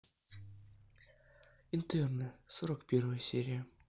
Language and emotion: Russian, neutral